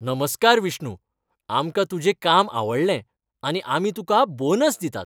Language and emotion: Goan Konkani, happy